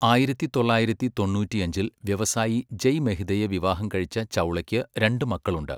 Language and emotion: Malayalam, neutral